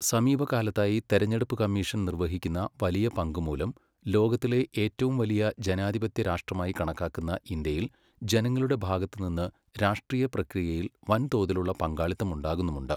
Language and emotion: Malayalam, neutral